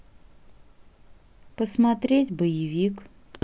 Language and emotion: Russian, neutral